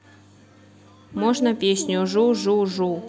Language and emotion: Russian, neutral